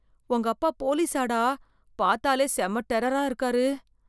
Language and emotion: Tamil, fearful